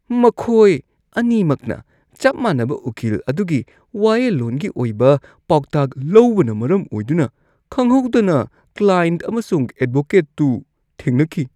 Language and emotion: Manipuri, disgusted